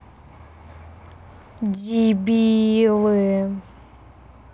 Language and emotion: Russian, angry